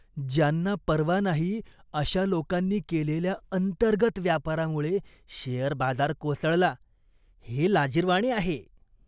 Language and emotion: Marathi, disgusted